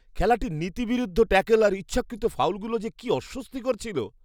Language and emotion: Bengali, disgusted